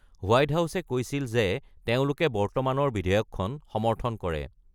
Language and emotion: Assamese, neutral